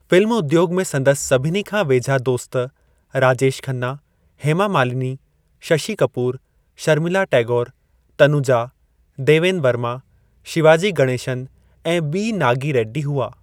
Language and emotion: Sindhi, neutral